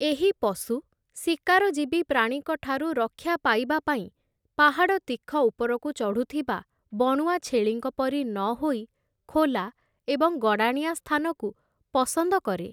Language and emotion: Odia, neutral